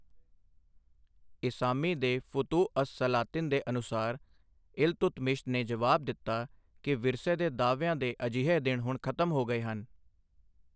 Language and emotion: Punjabi, neutral